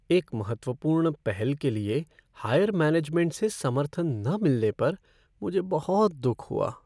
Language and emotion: Hindi, sad